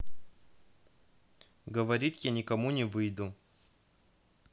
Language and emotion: Russian, neutral